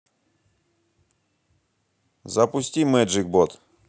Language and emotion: Russian, neutral